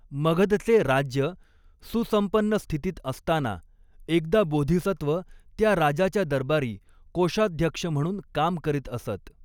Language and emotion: Marathi, neutral